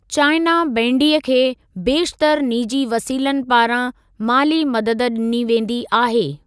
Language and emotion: Sindhi, neutral